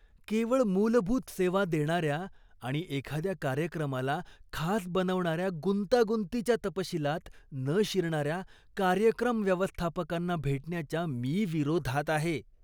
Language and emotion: Marathi, disgusted